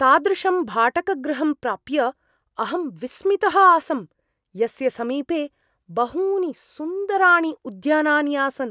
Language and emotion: Sanskrit, surprised